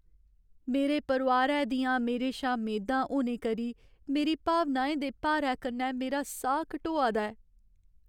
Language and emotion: Dogri, sad